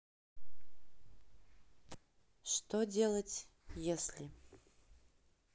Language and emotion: Russian, neutral